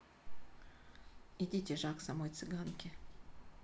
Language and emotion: Russian, neutral